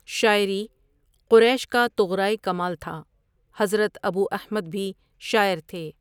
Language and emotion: Urdu, neutral